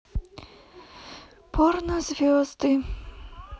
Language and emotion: Russian, sad